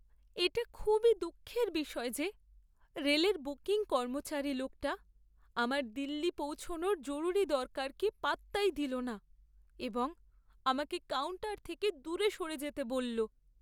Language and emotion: Bengali, sad